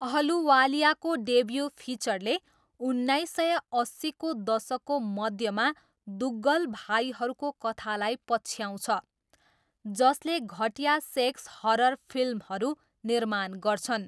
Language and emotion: Nepali, neutral